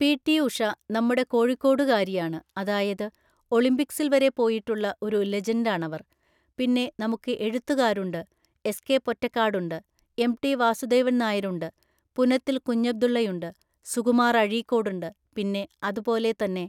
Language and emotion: Malayalam, neutral